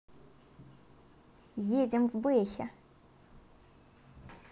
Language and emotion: Russian, positive